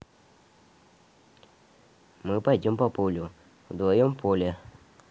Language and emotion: Russian, neutral